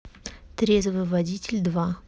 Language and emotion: Russian, neutral